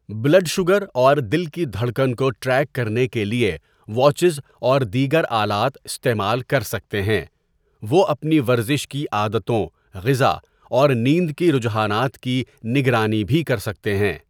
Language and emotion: Urdu, neutral